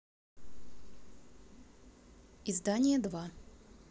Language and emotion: Russian, neutral